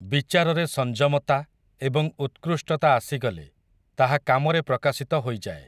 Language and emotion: Odia, neutral